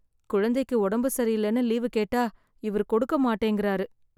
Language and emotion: Tamil, sad